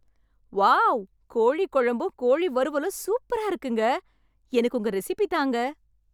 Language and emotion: Tamil, happy